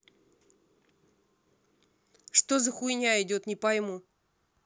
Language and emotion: Russian, angry